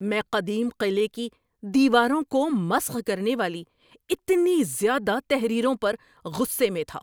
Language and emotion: Urdu, angry